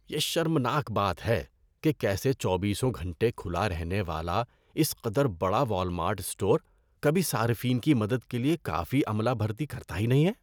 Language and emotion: Urdu, disgusted